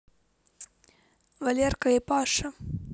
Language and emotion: Russian, neutral